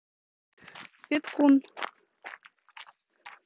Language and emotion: Russian, neutral